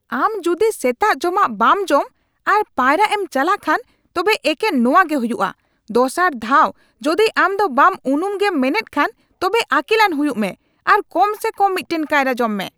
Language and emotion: Santali, angry